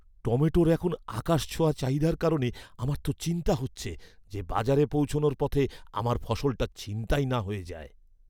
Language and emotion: Bengali, fearful